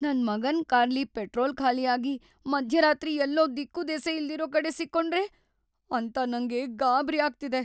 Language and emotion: Kannada, fearful